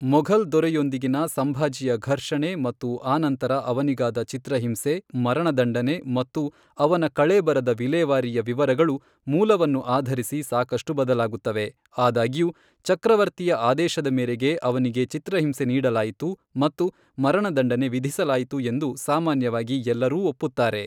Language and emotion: Kannada, neutral